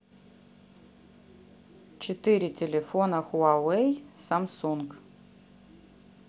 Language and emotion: Russian, neutral